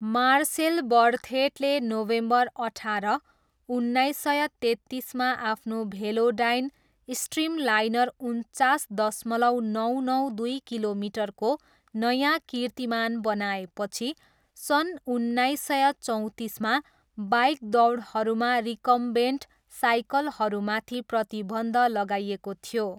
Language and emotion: Nepali, neutral